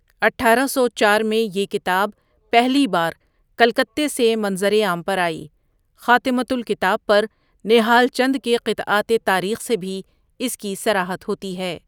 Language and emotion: Urdu, neutral